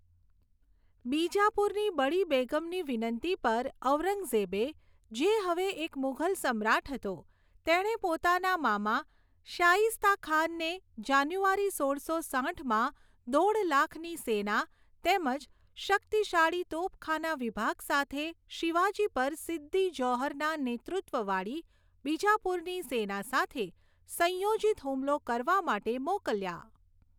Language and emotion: Gujarati, neutral